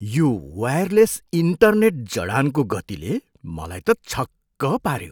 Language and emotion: Nepali, surprised